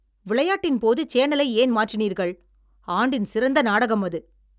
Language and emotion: Tamil, angry